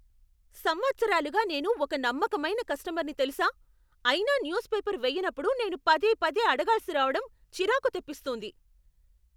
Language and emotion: Telugu, angry